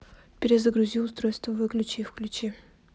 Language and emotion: Russian, neutral